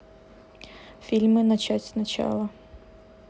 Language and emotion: Russian, neutral